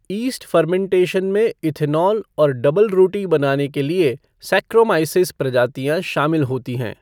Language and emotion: Hindi, neutral